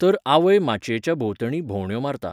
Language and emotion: Goan Konkani, neutral